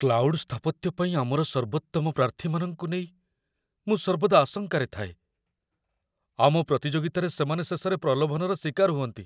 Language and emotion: Odia, fearful